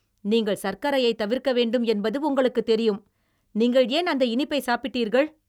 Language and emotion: Tamil, angry